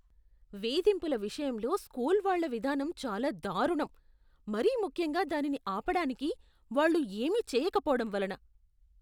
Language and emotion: Telugu, disgusted